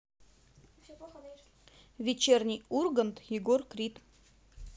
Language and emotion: Russian, neutral